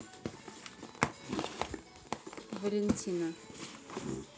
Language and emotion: Russian, neutral